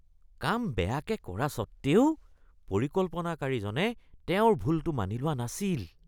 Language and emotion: Assamese, disgusted